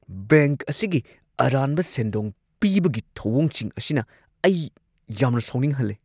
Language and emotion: Manipuri, angry